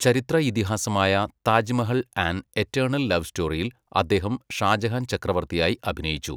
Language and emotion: Malayalam, neutral